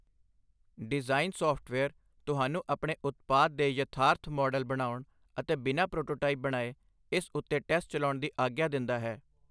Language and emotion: Punjabi, neutral